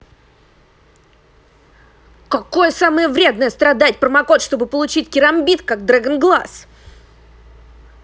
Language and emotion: Russian, angry